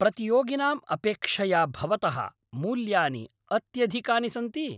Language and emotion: Sanskrit, angry